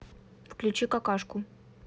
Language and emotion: Russian, neutral